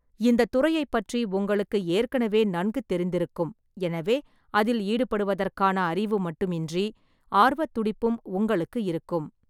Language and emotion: Tamil, neutral